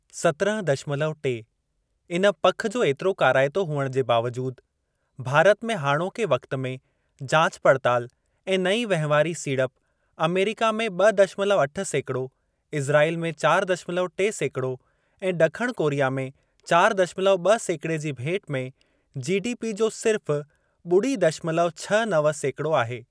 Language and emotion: Sindhi, neutral